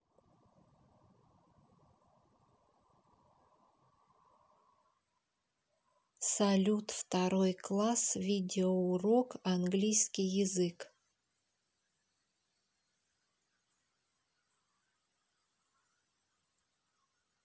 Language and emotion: Russian, neutral